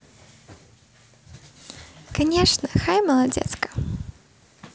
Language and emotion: Russian, positive